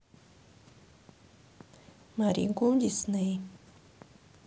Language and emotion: Russian, neutral